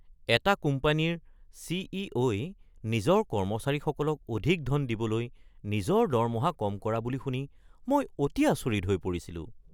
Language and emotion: Assamese, surprised